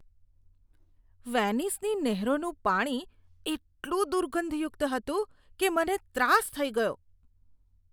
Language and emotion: Gujarati, disgusted